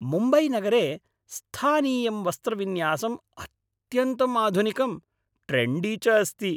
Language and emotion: Sanskrit, happy